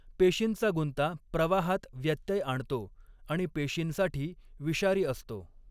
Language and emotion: Marathi, neutral